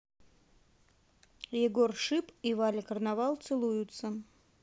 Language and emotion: Russian, neutral